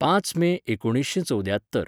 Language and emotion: Goan Konkani, neutral